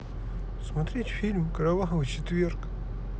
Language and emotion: Russian, sad